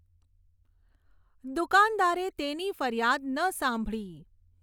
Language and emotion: Gujarati, neutral